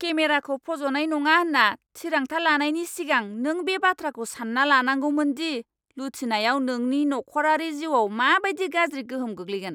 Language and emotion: Bodo, angry